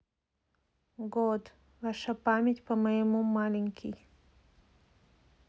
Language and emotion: Russian, neutral